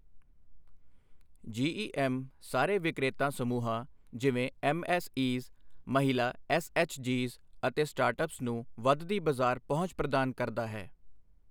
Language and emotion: Punjabi, neutral